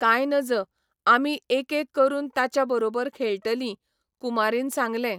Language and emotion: Goan Konkani, neutral